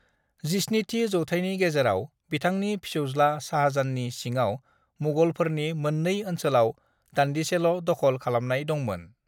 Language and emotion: Bodo, neutral